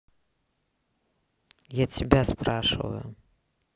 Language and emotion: Russian, neutral